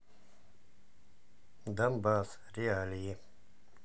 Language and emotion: Russian, neutral